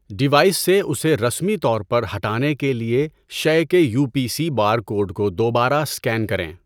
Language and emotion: Urdu, neutral